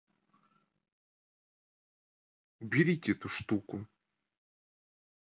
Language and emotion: Russian, neutral